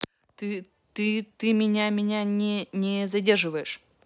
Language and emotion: Russian, neutral